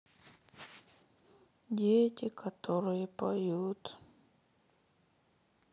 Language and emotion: Russian, sad